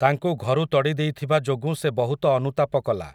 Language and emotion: Odia, neutral